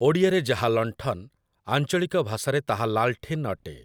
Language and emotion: Odia, neutral